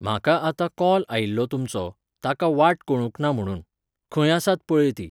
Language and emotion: Goan Konkani, neutral